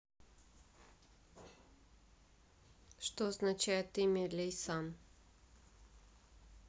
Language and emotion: Russian, neutral